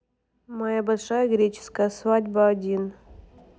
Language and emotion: Russian, neutral